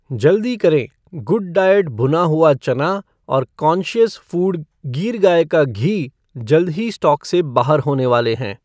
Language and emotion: Hindi, neutral